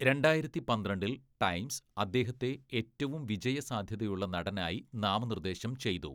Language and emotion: Malayalam, neutral